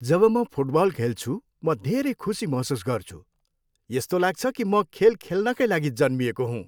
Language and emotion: Nepali, happy